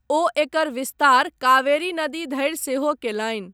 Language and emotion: Maithili, neutral